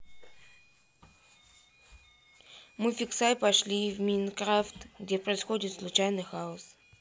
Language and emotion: Russian, neutral